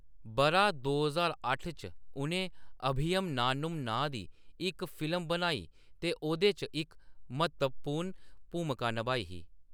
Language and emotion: Dogri, neutral